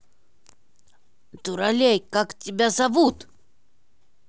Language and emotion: Russian, angry